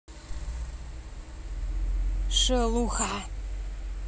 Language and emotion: Russian, angry